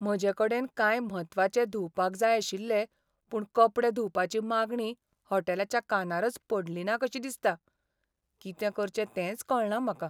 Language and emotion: Goan Konkani, sad